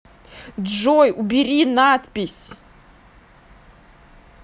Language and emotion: Russian, angry